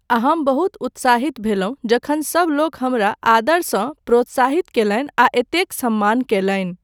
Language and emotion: Maithili, neutral